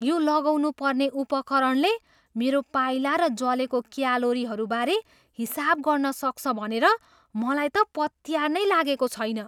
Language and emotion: Nepali, surprised